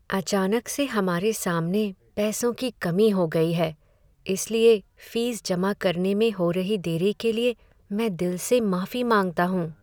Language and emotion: Hindi, sad